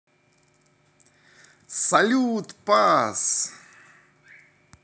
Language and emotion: Russian, positive